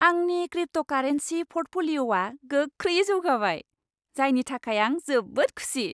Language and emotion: Bodo, happy